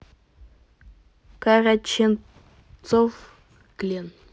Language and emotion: Russian, neutral